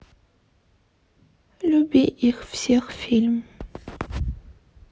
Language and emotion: Russian, sad